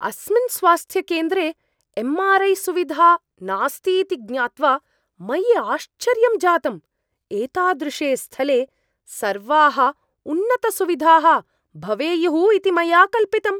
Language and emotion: Sanskrit, surprised